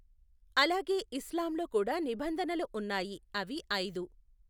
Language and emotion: Telugu, neutral